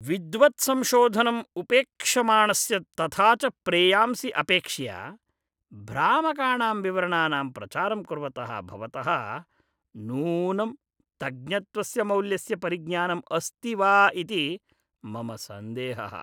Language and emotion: Sanskrit, disgusted